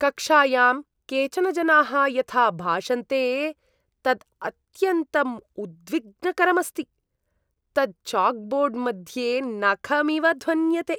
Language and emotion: Sanskrit, disgusted